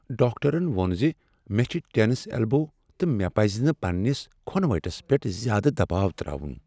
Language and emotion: Kashmiri, sad